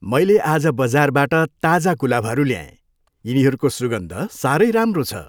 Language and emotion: Nepali, happy